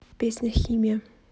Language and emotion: Russian, neutral